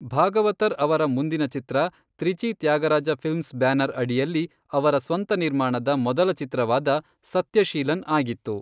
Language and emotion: Kannada, neutral